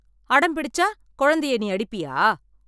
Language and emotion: Tamil, angry